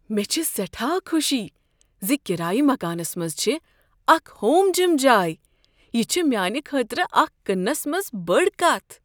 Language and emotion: Kashmiri, surprised